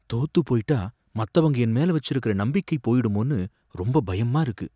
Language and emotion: Tamil, fearful